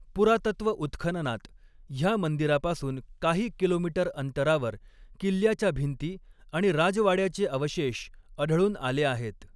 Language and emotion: Marathi, neutral